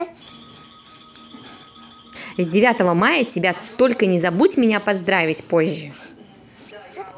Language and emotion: Russian, positive